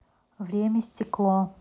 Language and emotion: Russian, neutral